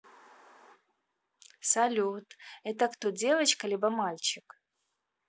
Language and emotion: Russian, neutral